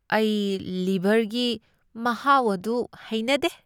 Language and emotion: Manipuri, disgusted